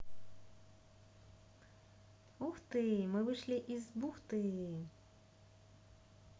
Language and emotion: Russian, positive